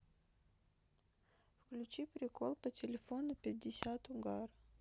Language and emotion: Russian, neutral